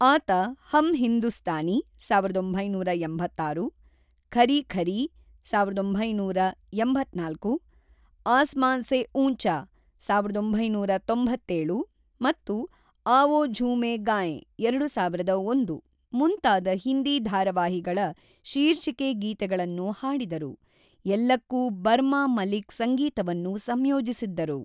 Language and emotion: Kannada, neutral